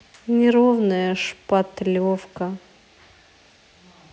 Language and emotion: Russian, sad